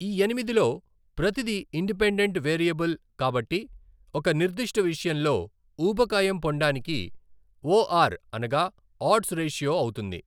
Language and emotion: Telugu, neutral